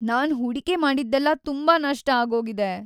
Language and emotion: Kannada, sad